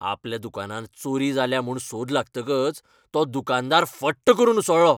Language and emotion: Goan Konkani, angry